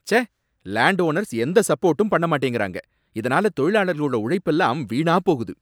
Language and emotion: Tamil, angry